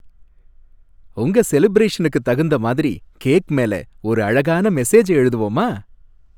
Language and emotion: Tamil, happy